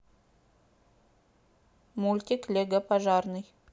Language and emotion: Russian, neutral